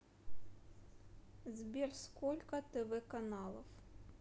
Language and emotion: Russian, neutral